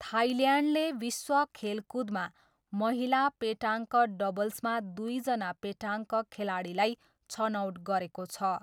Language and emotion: Nepali, neutral